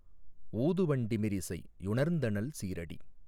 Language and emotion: Tamil, neutral